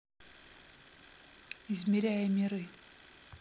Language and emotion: Russian, neutral